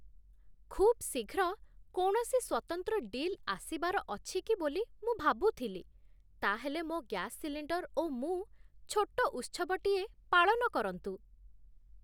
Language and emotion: Odia, surprised